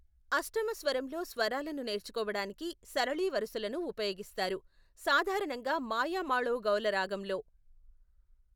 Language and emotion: Telugu, neutral